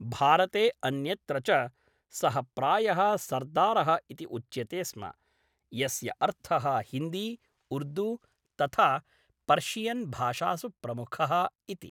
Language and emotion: Sanskrit, neutral